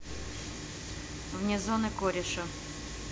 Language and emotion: Russian, neutral